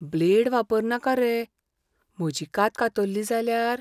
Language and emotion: Goan Konkani, fearful